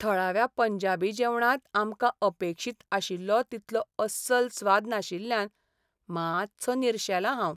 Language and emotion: Goan Konkani, sad